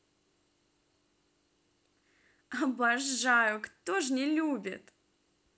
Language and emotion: Russian, positive